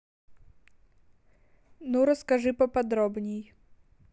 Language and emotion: Russian, neutral